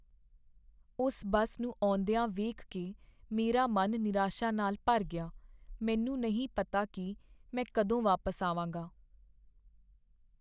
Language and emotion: Punjabi, sad